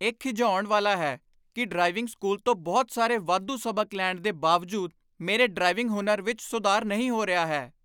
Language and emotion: Punjabi, angry